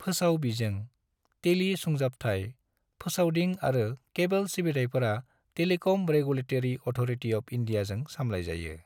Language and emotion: Bodo, neutral